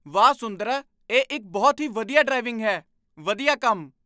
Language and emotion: Punjabi, surprised